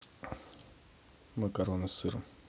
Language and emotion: Russian, neutral